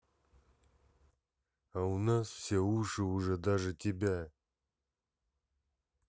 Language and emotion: Russian, angry